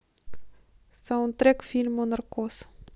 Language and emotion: Russian, neutral